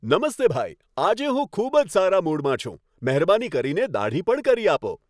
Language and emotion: Gujarati, happy